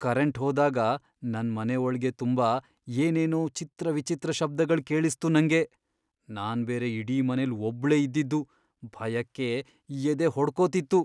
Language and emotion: Kannada, fearful